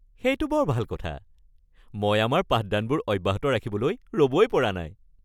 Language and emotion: Assamese, happy